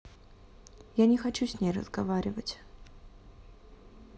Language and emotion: Russian, sad